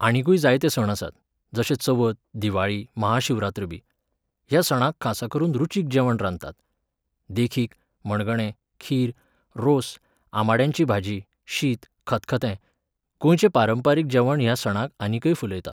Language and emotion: Goan Konkani, neutral